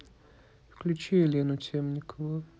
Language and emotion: Russian, neutral